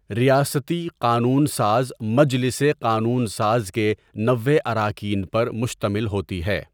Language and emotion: Urdu, neutral